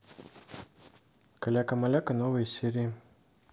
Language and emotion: Russian, neutral